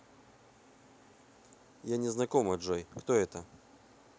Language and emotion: Russian, neutral